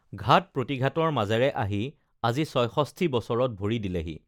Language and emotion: Assamese, neutral